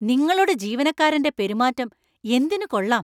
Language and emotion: Malayalam, angry